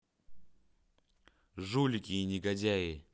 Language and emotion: Russian, angry